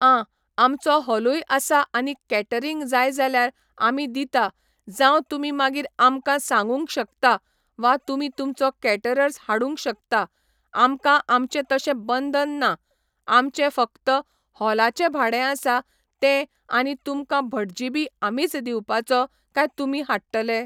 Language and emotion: Goan Konkani, neutral